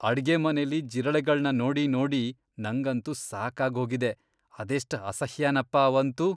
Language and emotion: Kannada, disgusted